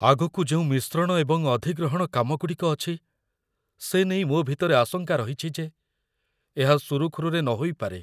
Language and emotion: Odia, fearful